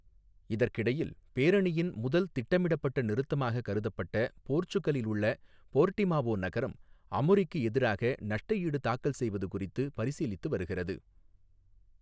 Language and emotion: Tamil, neutral